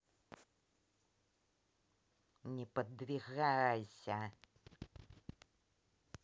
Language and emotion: Russian, angry